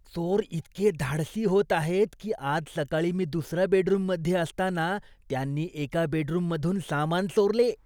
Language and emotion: Marathi, disgusted